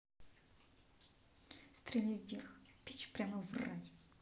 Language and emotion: Russian, angry